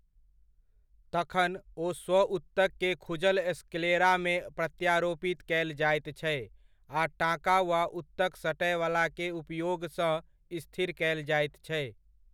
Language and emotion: Maithili, neutral